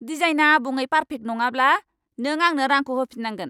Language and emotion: Bodo, angry